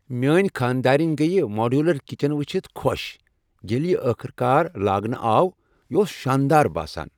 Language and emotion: Kashmiri, happy